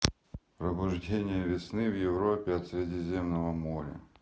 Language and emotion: Russian, neutral